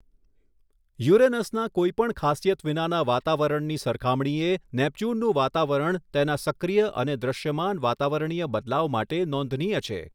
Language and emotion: Gujarati, neutral